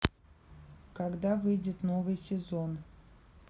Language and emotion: Russian, neutral